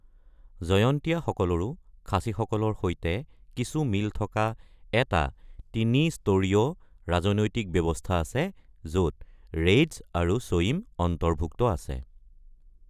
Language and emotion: Assamese, neutral